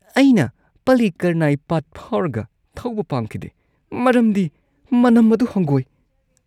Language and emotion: Manipuri, disgusted